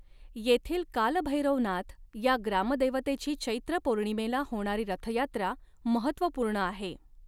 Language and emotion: Marathi, neutral